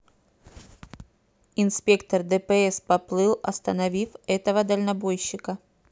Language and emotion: Russian, neutral